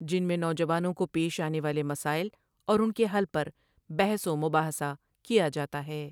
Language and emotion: Urdu, neutral